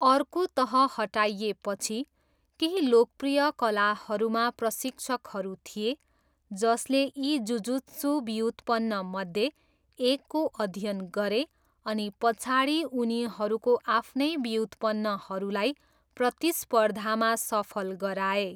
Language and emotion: Nepali, neutral